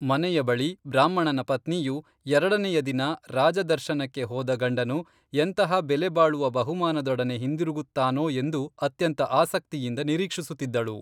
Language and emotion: Kannada, neutral